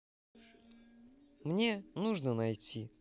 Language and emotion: Russian, positive